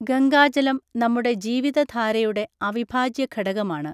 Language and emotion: Malayalam, neutral